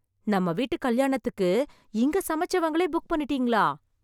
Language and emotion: Tamil, surprised